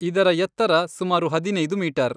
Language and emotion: Kannada, neutral